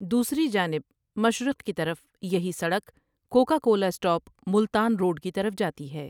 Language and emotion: Urdu, neutral